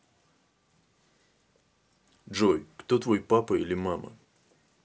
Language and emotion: Russian, neutral